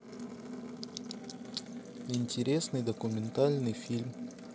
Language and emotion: Russian, neutral